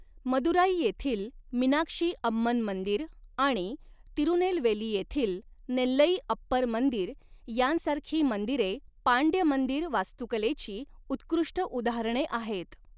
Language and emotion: Marathi, neutral